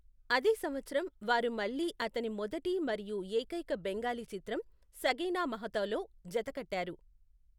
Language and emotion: Telugu, neutral